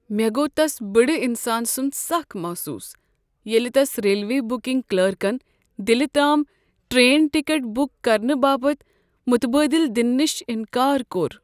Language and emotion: Kashmiri, sad